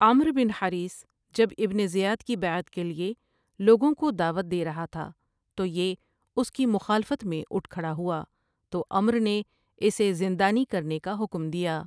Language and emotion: Urdu, neutral